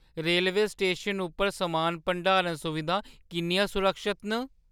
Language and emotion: Dogri, fearful